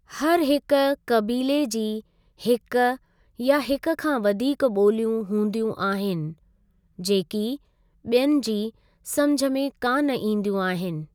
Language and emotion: Sindhi, neutral